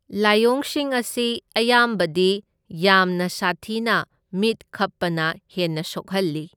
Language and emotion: Manipuri, neutral